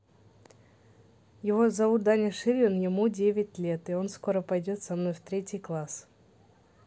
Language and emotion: Russian, neutral